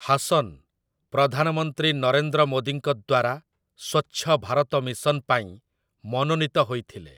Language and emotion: Odia, neutral